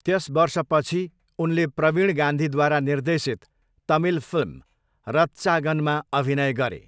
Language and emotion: Nepali, neutral